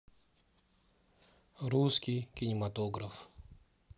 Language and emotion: Russian, neutral